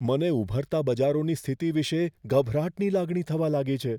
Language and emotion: Gujarati, fearful